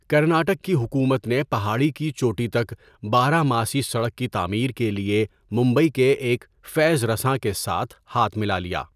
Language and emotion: Urdu, neutral